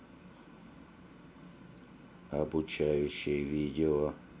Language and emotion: Russian, neutral